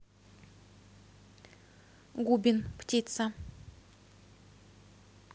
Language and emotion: Russian, neutral